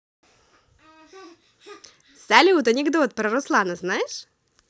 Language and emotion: Russian, positive